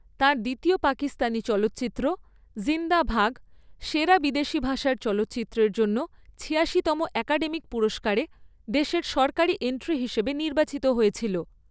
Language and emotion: Bengali, neutral